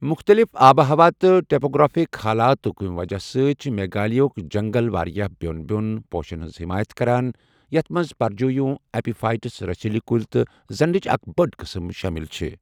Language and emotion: Kashmiri, neutral